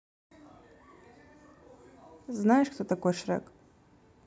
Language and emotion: Russian, neutral